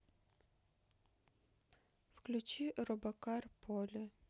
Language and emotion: Russian, neutral